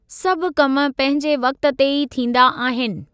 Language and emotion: Sindhi, neutral